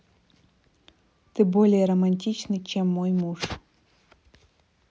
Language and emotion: Russian, neutral